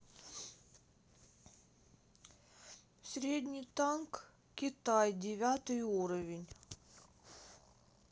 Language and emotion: Russian, neutral